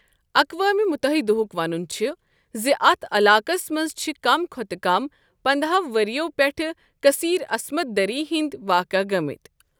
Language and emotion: Kashmiri, neutral